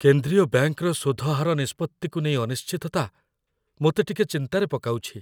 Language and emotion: Odia, fearful